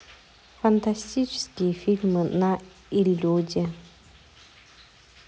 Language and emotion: Russian, neutral